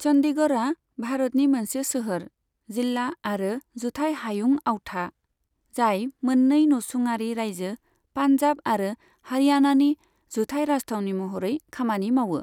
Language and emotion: Bodo, neutral